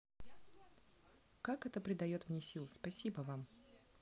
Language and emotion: Russian, neutral